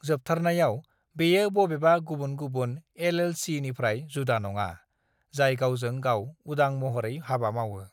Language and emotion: Bodo, neutral